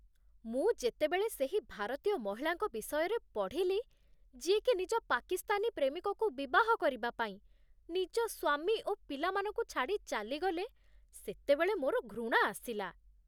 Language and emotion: Odia, disgusted